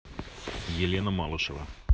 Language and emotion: Russian, neutral